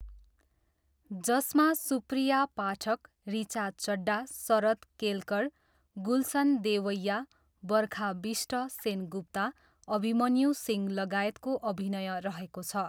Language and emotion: Nepali, neutral